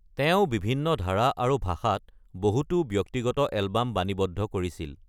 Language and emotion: Assamese, neutral